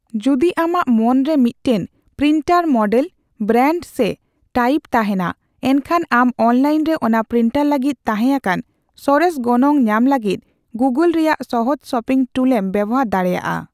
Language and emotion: Santali, neutral